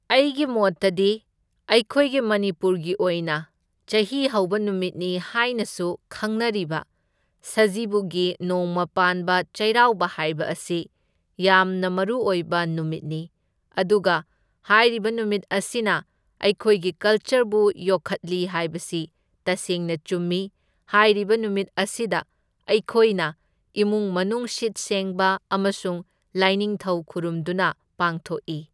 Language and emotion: Manipuri, neutral